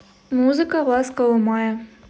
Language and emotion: Russian, neutral